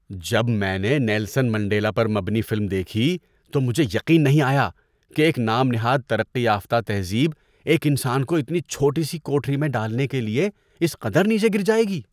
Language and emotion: Urdu, disgusted